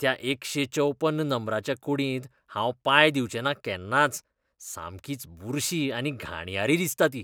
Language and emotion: Goan Konkani, disgusted